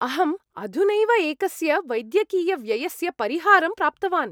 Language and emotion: Sanskrit, happy